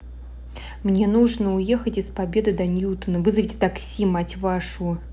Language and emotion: Russian, angry